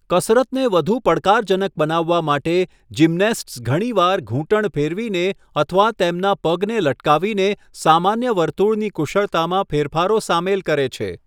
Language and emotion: Gujarati, neutral